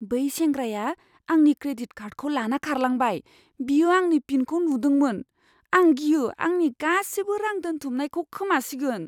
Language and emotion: Bodo, fearful